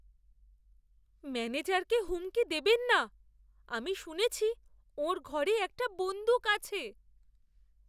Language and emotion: Bengali, fearful